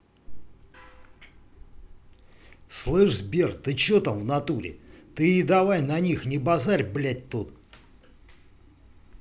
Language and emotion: Russian, angry